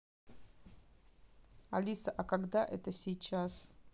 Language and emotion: Russian, neutral